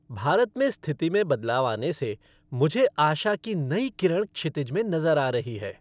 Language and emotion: Hindi, happy